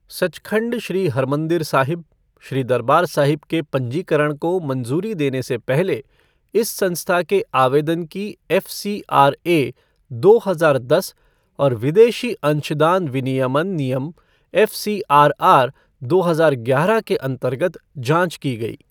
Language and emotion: Hindi, neutral